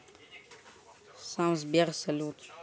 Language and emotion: Russian, neutral